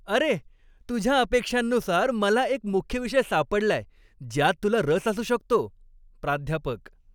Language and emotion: Marathi, happy